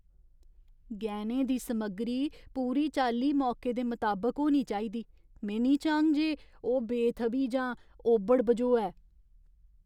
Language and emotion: Dogri, fearful